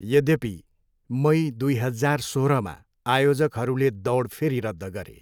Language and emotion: Nepali, neutral